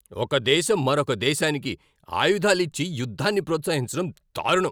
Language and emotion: Telugu, angry